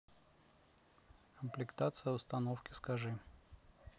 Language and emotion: Russian, neutral